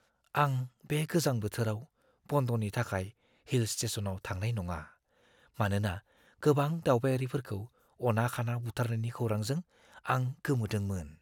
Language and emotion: Bodo, fearful